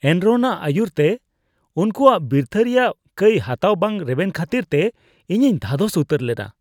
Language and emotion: Santali, disgusted